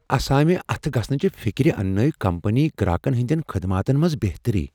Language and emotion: Kashmiri, fearful